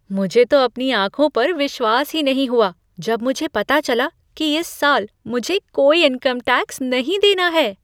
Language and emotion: Hindi, surprised